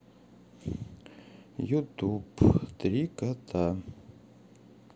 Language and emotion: Russian, sad